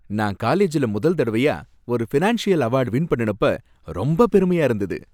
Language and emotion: Tamil, happy